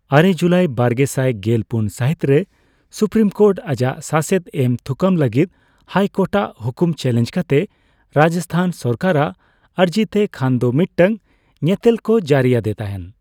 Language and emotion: Santali, neutral